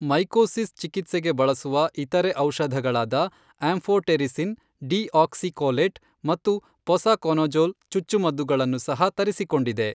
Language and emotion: Kannada, neutral